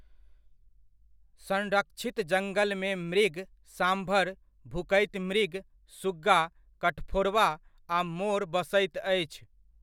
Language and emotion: Maithili, neutral